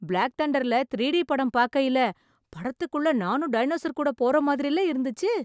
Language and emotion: Tamil, surprised